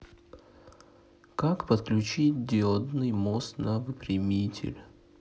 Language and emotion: Russian, neutral